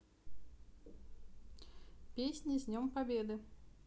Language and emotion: Russian, neutral